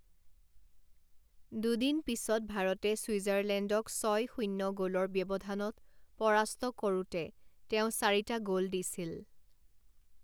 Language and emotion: Assamese, neutral